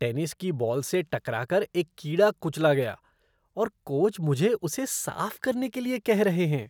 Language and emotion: Hindi, disgusted